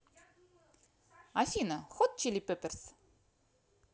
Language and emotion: Russian, positive